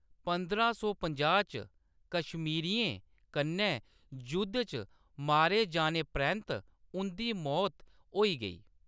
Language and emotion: Dogri, neutral